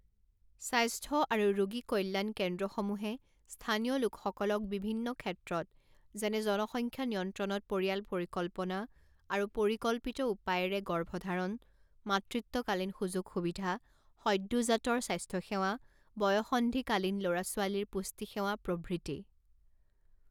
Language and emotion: Assamese, neutral